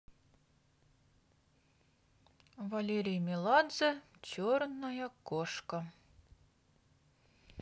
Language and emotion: Russian, neutral